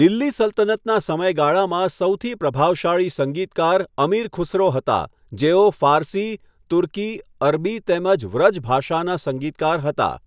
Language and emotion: Gujarati, neutral